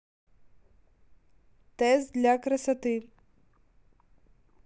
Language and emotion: Russian, neutral